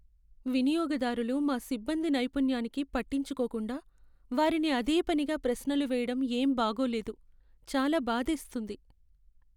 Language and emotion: Telugu, sad